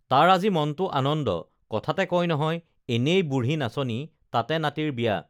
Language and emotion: Assamese, neutral